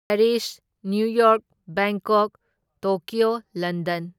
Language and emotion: Manipuri, neutral